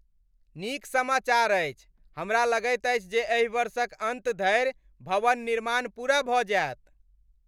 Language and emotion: Maithili, happy